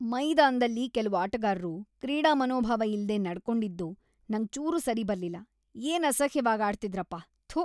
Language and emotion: Kannada, disgusted